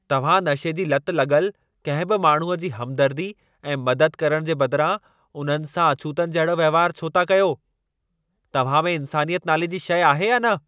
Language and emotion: Sindhi, angry